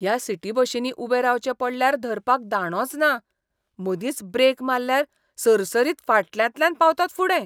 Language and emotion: Goan Konkani, disgusted